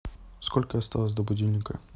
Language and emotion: Russian, neutral